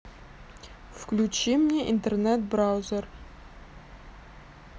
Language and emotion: Russian, neutral